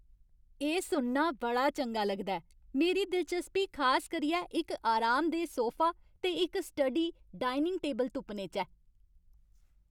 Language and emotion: Dogri, happy